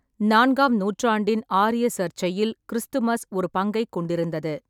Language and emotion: Tamil, neutral